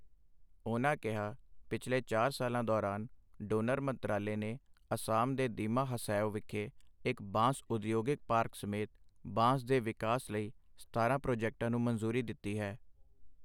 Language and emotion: Punjabi, neutral